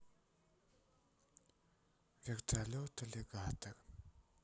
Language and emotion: Russian, sad